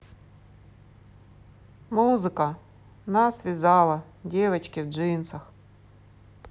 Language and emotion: Russian, sad